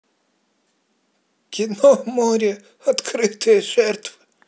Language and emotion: Russian, positive